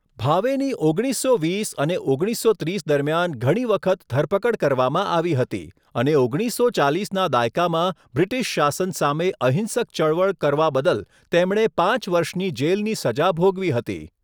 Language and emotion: Gujarati, neutral